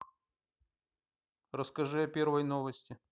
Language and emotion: Russian, neutral